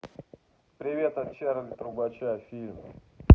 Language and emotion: Russian, neutral